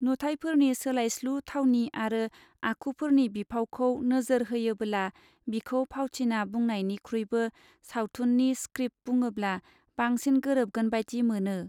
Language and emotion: Bodo, neutral